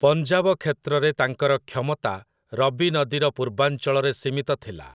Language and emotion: Odia, neutral